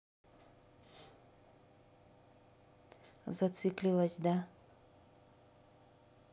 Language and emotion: Russian, neutral